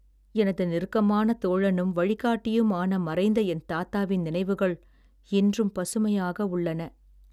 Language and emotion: Tamil, sad